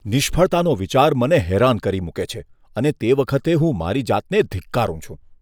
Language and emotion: Gujarati, disgusted